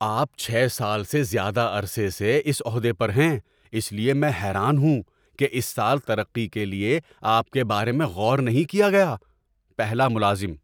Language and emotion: Urdu, surprised